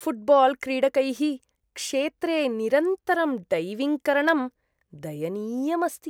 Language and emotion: Sanskrit, disgusted